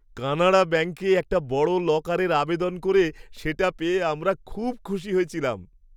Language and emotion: Bengali, happy